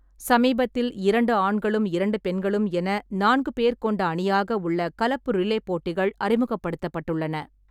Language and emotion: Tamil, neutral